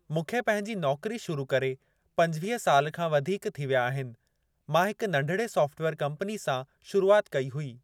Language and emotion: Sindhi, neutral